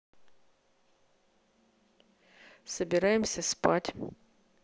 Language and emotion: Russian, neutral